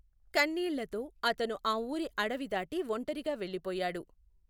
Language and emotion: Telugu, neutral